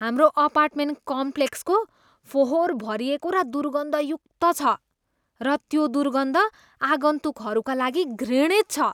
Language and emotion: Nepali, disgusted